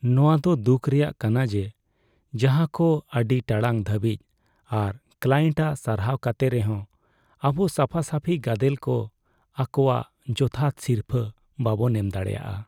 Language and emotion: Santali, sad